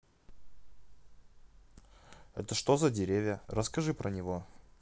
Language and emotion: Russian, neutral